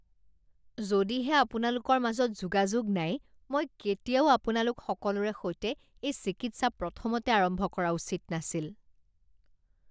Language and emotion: Assamese, disgusted